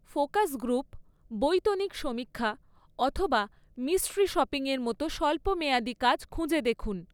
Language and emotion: Bengali, neutral